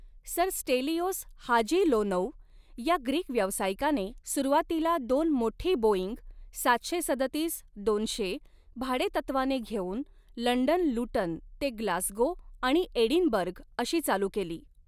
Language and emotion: Marathi, neutral